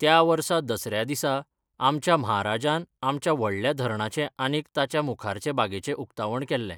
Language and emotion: Goan Konkani, neutral